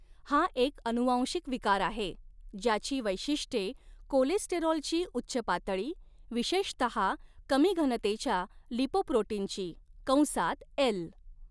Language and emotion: Marathi, neutral